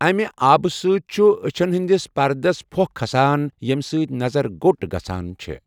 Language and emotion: Kashmiri, neutral